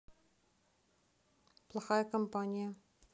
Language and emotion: Russian, neutral